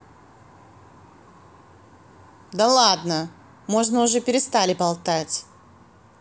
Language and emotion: Russian, angry